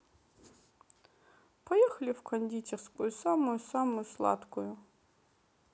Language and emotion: Russian, sad